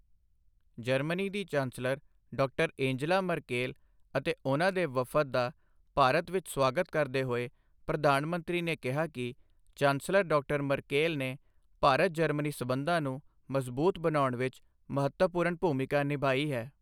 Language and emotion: Punjabi, neutral